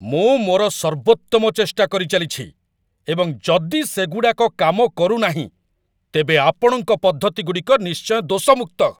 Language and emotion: Odia, angry